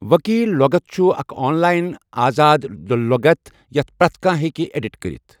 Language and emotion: Kashmiri, neutral